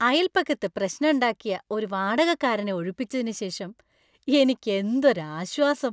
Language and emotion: Malayalam, happy